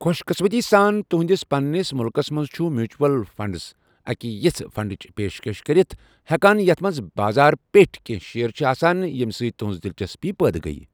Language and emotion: Kashmiri, neutral